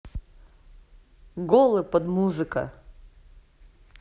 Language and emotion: Russian, neutral